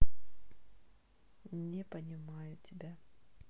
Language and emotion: Russian, neutral